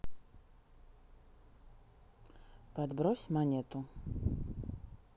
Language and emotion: Russian, neutral